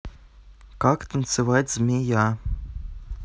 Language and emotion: Russian, neutral